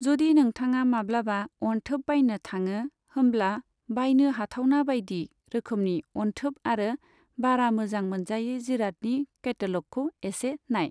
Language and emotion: Bodo, neutral